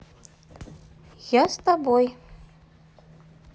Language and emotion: Russian, neutral